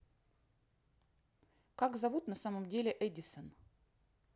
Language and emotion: Russian, neutral